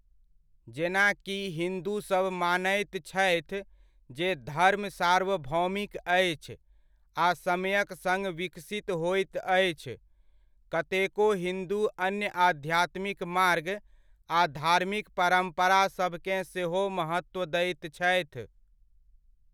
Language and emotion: Maithili, neutral